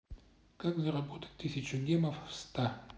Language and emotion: Russian, neutral